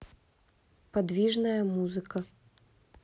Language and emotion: Russian, neutral